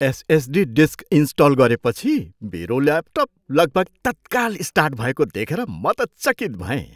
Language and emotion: Nepali, surprised